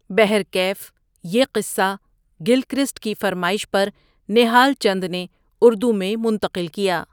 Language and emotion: Urdu, neutral